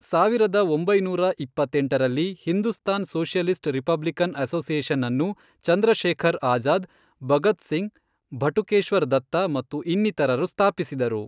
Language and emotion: Kannada, neutral